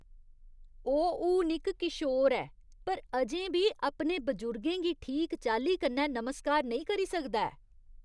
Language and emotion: Dogri, disgusted